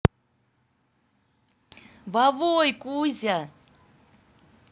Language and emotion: Russian, positive